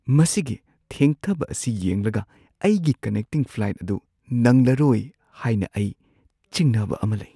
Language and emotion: Manipuri, fearful